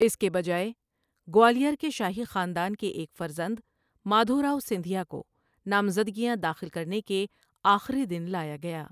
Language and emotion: Urdu, neutral